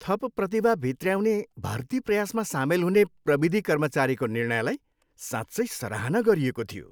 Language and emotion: Nepali, happy